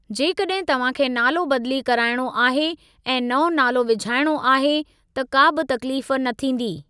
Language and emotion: Sindhi, neutral